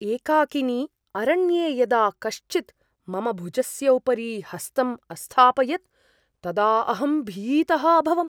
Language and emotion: Sanskrit, surprised